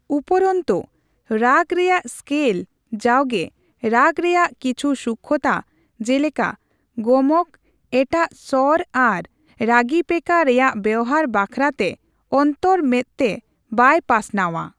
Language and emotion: Santali, neutral